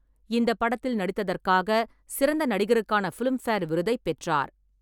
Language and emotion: Tamil, neutral